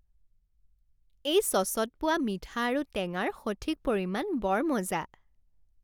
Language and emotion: Assamese, happy